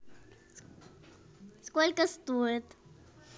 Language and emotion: Russian, positive